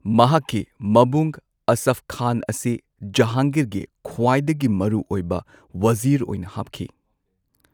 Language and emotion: Manipuri, neutral